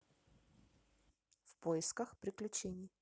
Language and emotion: Russian, neutral